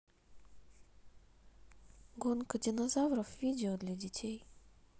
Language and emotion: Russian, neutral